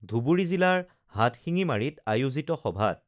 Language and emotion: Assamese, neutral